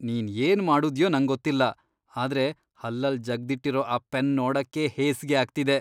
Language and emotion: Kannada, disgusted